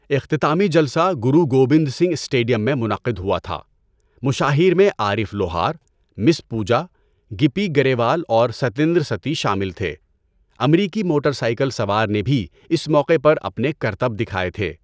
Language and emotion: Urdu, neutral